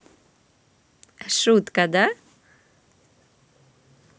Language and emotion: Russian, positive